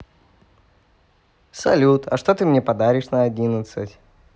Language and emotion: Russian, positive